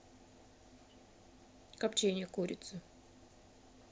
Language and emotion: Russian, neutral